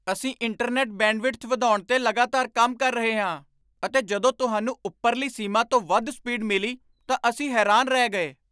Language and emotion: Punjabi, surprised